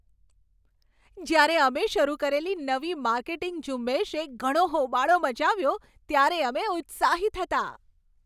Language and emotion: Gujarati, happy